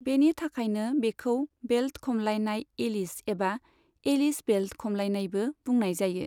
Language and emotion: Bodo, neutral